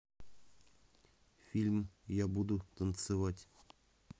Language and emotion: Russian, neutral